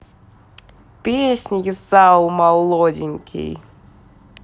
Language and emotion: Russian, positive